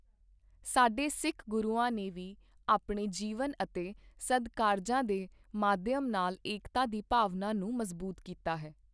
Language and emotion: Punjabi, neutral